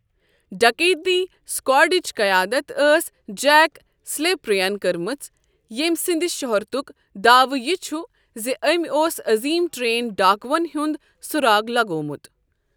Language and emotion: Kashmiri, neutral